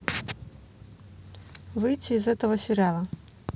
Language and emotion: Russian, neutral